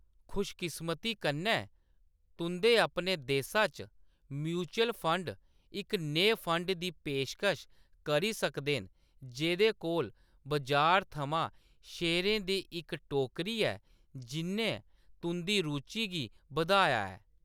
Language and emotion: Dogri, neutral